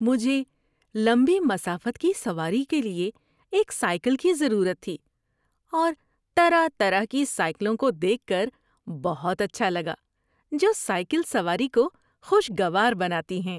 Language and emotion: Urdu, happy